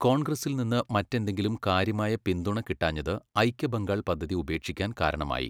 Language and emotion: Malayalam, neutral